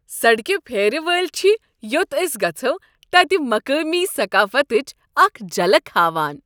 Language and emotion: Kashmiri, happy